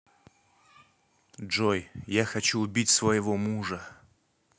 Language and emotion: Russian, angry